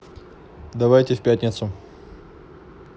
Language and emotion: Russian, neutral